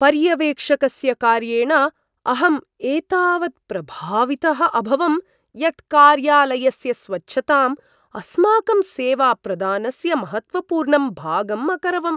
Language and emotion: Sanskrit, surprised